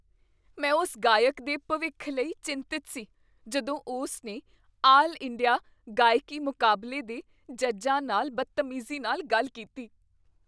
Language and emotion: Punjabi, fearful